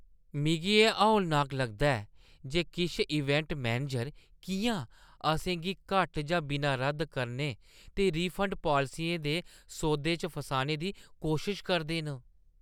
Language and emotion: Dogri, disgusted